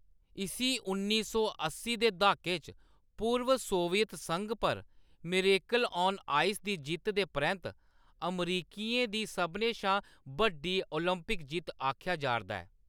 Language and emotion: Dogri, neutral